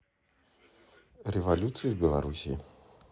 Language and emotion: Russian, neutral